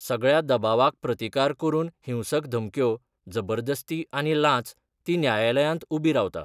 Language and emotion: Goan Konkani, neutral